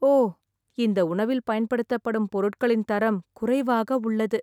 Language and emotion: Tamil, sad